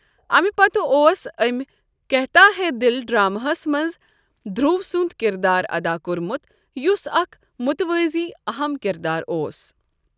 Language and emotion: Kashmiri, neutral